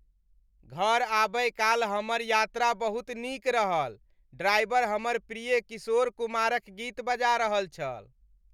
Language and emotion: Maithili, happy